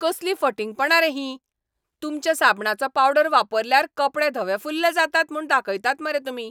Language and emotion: Goan Konkani, angry